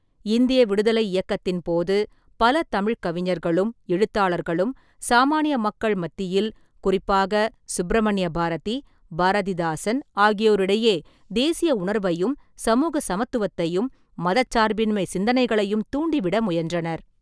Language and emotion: Tamil, neutral